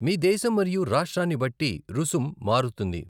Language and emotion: Telugu, neutral